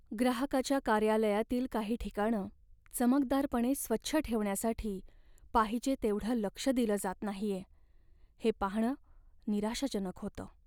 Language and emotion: Marathi, sad